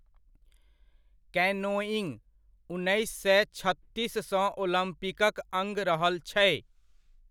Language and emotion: Maithili, neutral